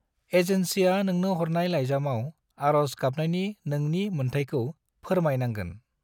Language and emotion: Bodo, neutral